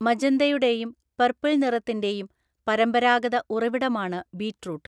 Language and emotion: Malayalam, neutral